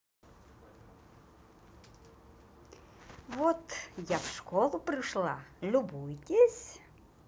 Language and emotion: Russian, positive